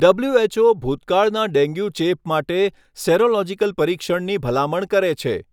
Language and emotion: Gujarati, neutral